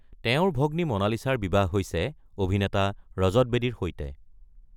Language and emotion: Assamese, neutral